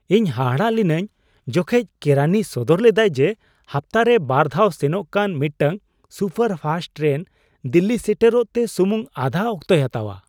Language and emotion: Santali, surprised